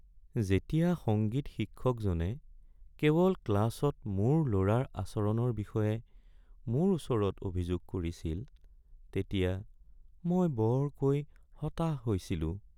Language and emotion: Assamese, sad